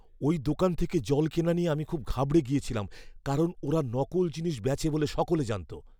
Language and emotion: Bengali, fearful